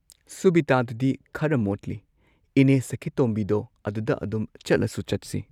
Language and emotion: Manipuri, neutral